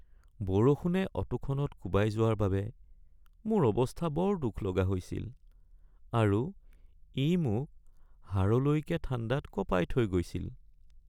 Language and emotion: Assamese, sad